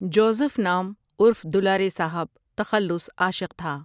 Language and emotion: Urdu, neutral